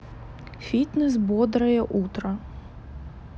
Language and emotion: Russian, neutral